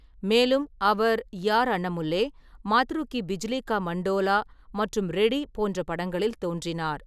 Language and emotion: Tamil, neutral